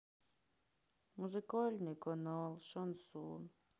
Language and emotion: Russian, sad